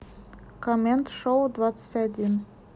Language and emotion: Russian, neutral